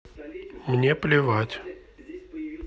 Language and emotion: Russian, neutral